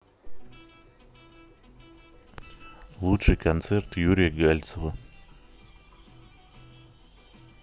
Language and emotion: Russian, neutral